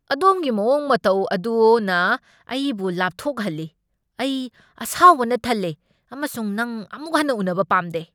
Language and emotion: Manipuri, angry